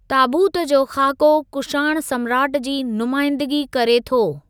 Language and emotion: Sindhi, neutral